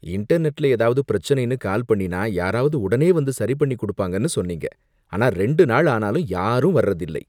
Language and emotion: Tamil, disgusted